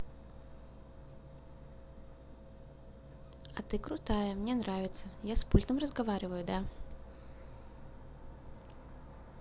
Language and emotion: Russian, positive